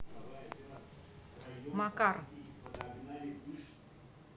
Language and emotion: Russian, neutral